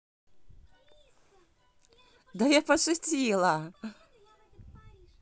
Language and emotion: Russian, positive